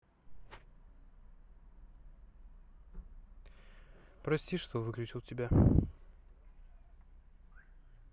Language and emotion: Russian, sad